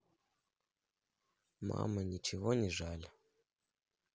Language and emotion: Russian, sad